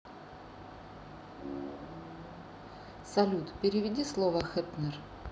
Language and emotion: Russian, neutral